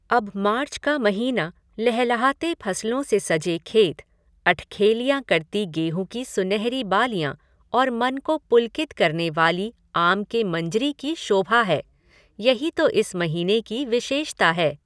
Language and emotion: Hindi, neutral